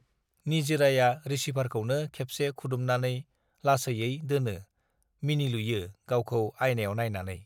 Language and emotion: Bodo, neutral